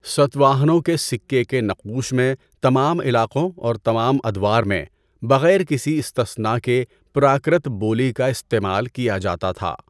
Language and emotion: Urdu, neutral